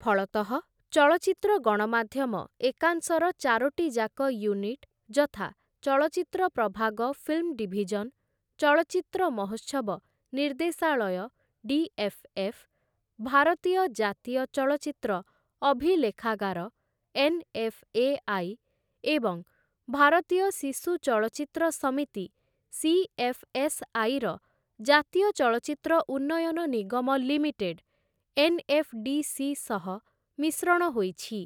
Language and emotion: Odia, neutral